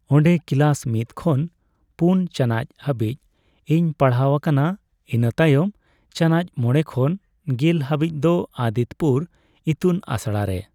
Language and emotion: Santali, neutral